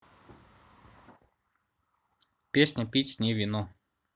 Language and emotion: Russian, neutral